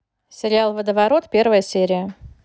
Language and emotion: Russian, neutral